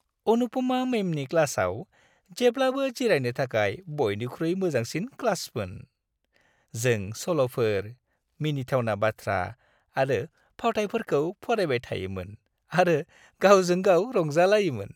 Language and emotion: Bodo, happy